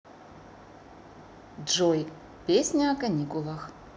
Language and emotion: Russian, neutral